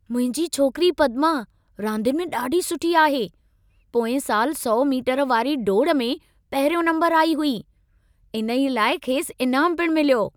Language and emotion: Sindhi, happy